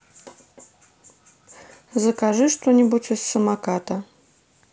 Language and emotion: Russian, neutral